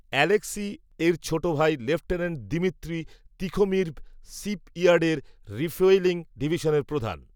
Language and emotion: Bengali, neutral